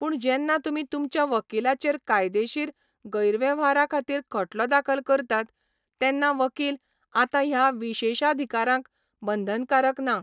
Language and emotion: Goan Konkani, neutral